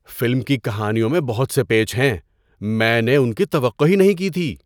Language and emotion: Urdu, surprised